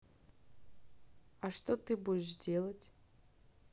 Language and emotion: Russian, neutral